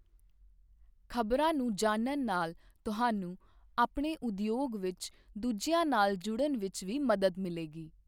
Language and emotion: Punjabi, neutral